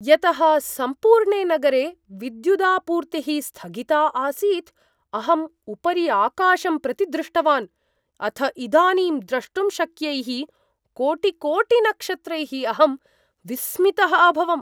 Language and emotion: Sanskrit, surprised